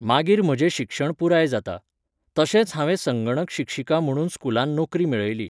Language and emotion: Goan Konkani, neutral